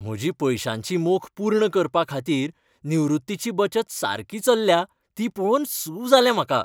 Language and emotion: Goan Konkani, happy